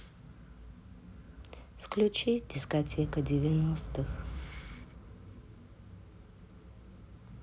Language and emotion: Russian, sad